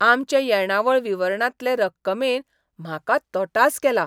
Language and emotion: Goan Konkani, surprised